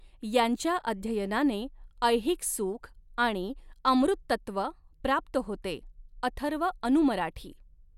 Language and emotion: Marathi, neutral